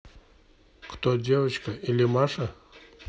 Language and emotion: Russian, neutral